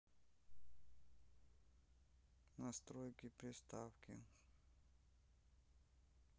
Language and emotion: Russian, sad